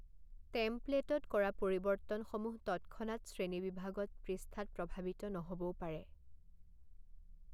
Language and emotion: Assamese, neutral